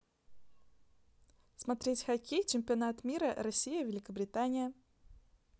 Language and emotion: Russian, neutral